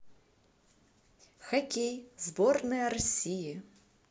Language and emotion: Russian, positive